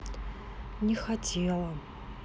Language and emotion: Russian, sad